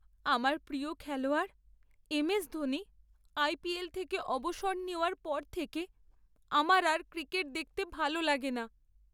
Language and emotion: Bengali, sad